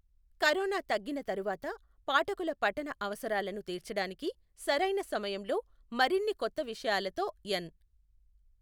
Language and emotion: Telugu, neutral